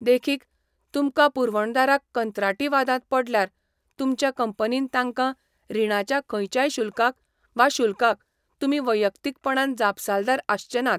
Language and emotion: Goan Konkani, neutral